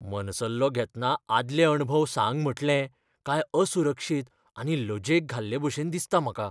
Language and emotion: Goan Konkani, fearful